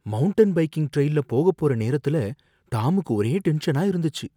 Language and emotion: Tamil, fearful